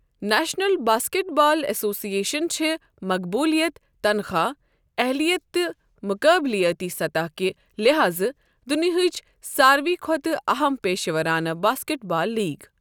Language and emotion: Kashmiri, neutral